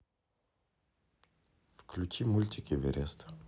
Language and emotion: Russian, neutral